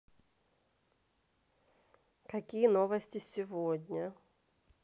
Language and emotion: Russian, neutral